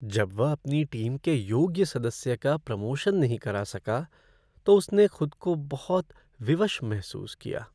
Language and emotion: Hindi, sad